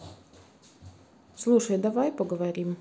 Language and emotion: Russian, neutral